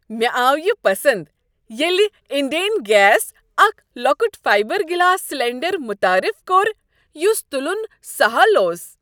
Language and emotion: Kashmiri, happy